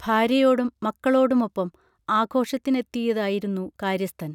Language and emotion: Malayalam, neutral